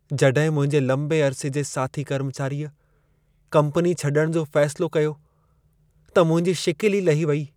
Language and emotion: Sindhi, sad